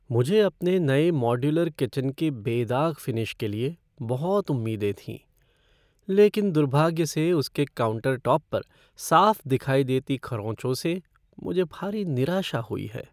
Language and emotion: Hindi, sad